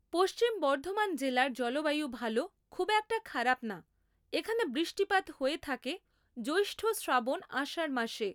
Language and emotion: Bengali, neutral